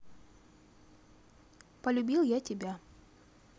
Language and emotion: Russian, neutral